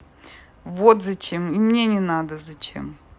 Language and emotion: Russian, neutral